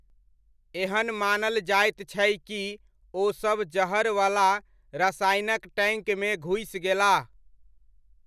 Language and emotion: Maithili, neutral